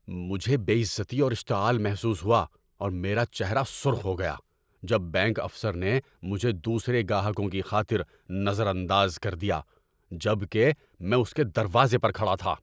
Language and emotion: Urdu, angry